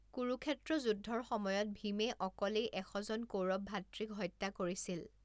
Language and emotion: Assamese, neutral